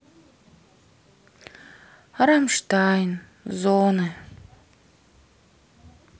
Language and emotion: Russian, sad